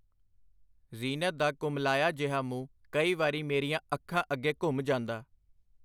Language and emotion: Punjabi, neutral